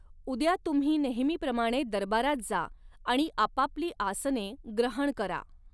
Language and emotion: Marathi, neutral